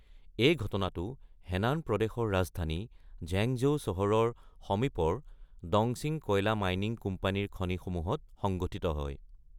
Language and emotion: Assamese, neutral